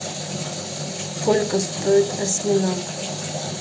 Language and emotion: Russian, neutral